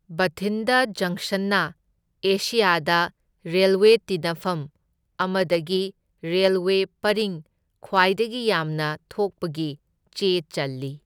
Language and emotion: Manipuri, neutral